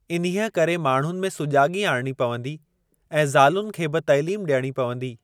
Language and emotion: Sindhi, neutral